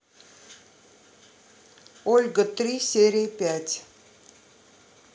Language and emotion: Russian, neutral